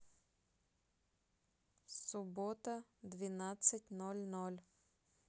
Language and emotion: Russian, neutral